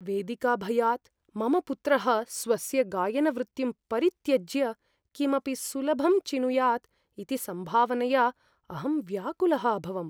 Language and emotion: Sanskrit, fearful